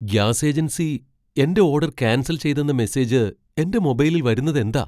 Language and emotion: Malayalam, surprised